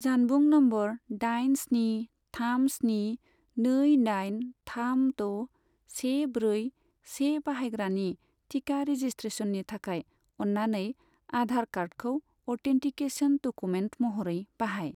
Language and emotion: Bodo, neutral